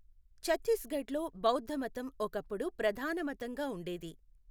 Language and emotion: Telugu, neutral